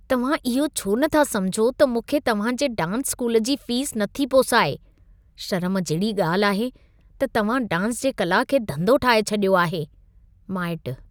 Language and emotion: Sindhi, disgusted